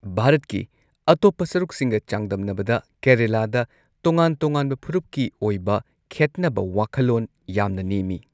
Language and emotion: Manipuri, neutral